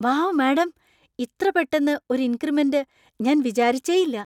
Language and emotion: Malayalam, surprised